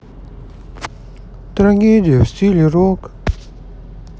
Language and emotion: Russian, sad